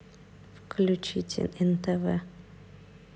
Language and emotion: Russian, neutral